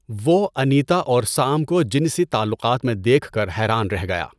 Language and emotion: Urdu, neutral